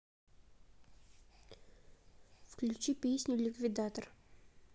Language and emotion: Russian, neutral